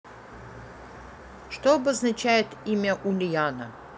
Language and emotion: Russian, neutral